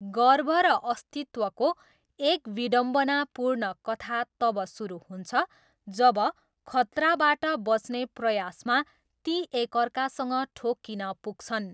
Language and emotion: Nepali, neutral